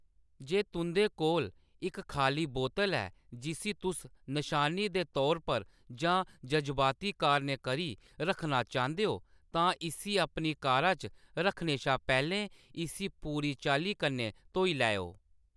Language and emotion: Dogri, neutral